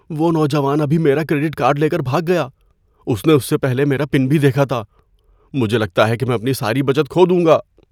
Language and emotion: Urdu, fearful